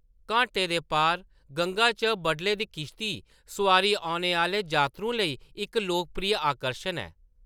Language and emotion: Dogri, neutral